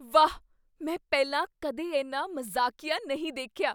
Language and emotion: Punjabi, surprised